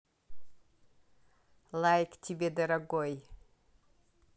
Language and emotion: Russian, positive